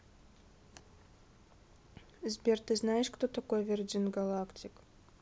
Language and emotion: Russian, neutral